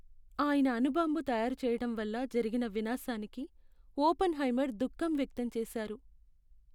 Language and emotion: Telugu, sad